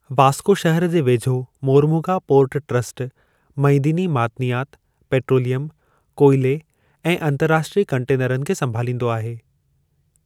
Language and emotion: Sindhi, neutral